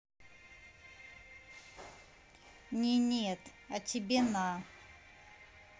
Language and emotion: Russian, neutral